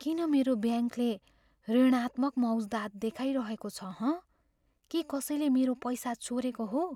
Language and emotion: Nepali, fearful